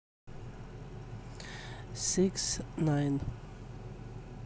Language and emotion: Russian, neutral